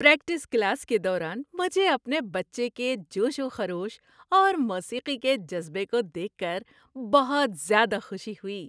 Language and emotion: Urdu, happy